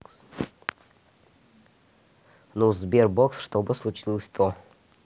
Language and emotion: Russian, neutral